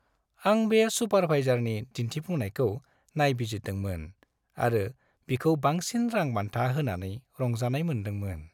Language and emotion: Bodo, happy